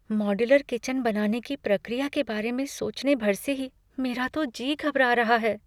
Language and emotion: Hindi, fearful